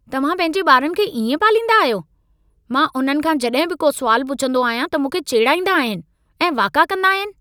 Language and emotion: Sindhi, angry